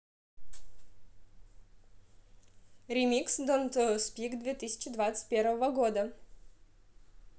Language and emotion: Russian, positive